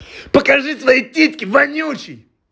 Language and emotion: Russian, angry